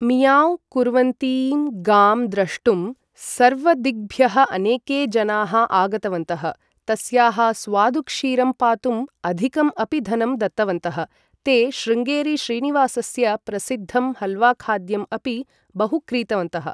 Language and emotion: Sanskrit, neutral